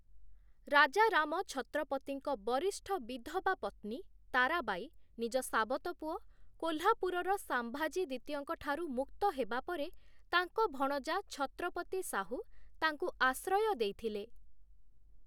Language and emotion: Odia, neutral